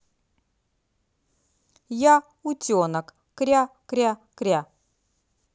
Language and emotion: Russian, positive